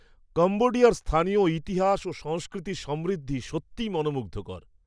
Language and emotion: Bengali, surprised